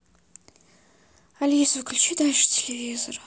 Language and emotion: Russian, sad